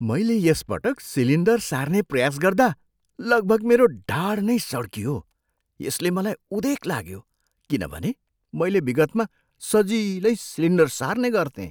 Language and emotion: Nepali, surprised